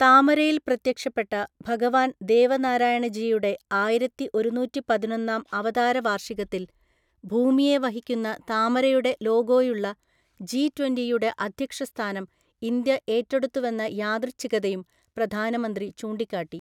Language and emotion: Malayalam, neutral